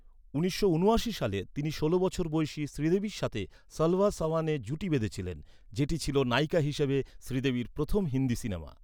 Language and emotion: Bengali, neutral